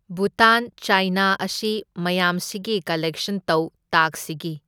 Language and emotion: Manipuri, neutral